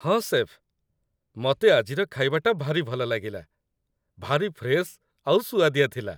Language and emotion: Odia, happy